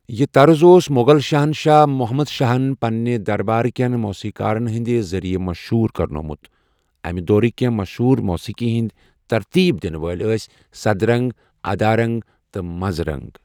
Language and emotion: Kashmiri, neutral